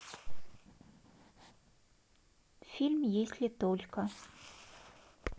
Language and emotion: Russian, neutral